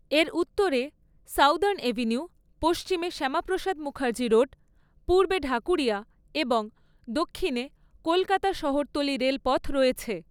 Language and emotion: Bengali, neutral